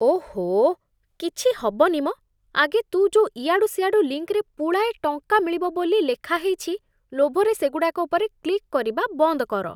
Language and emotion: Odia, disgusted